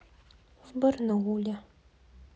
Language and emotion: Russian, neutral